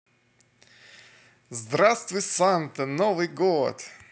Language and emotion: Russian, positive